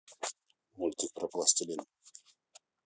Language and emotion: Russian, neutral